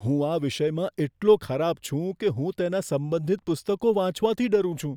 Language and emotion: Gujarati, fearful